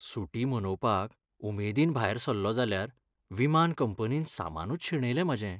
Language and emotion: Goan Konkani, sad